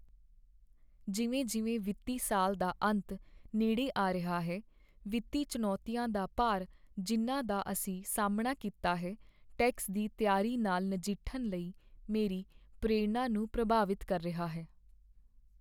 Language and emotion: Punjabi, sad